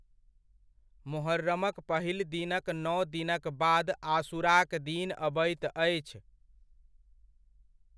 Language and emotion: Maithili, neutral